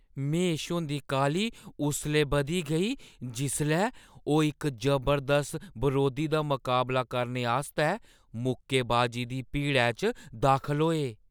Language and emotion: Dogri, fearful